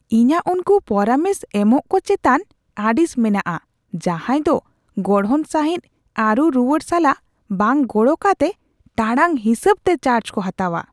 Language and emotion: Santali, disgusted